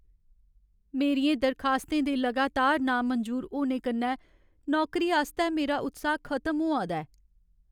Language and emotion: Dogri, sad